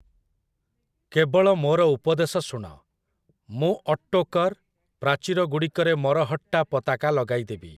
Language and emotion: Odia, neutral